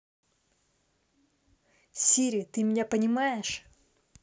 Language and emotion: Russian, neutral